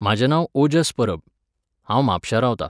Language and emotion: Goan Konkani, neutral